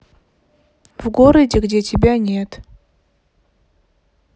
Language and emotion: Russian, neutral